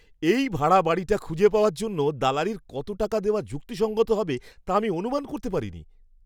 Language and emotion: Bengali, surprised